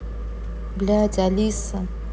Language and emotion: Russian, neutral